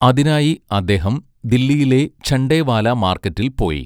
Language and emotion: Malayalam, neutral